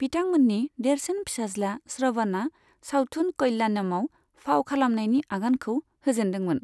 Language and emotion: Bodo, neutral